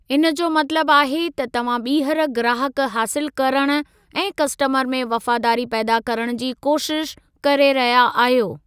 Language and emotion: Sindhi, neutral